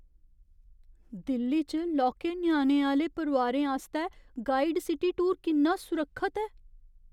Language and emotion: Dogri, fearful